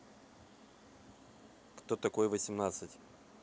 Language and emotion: Russian, neutral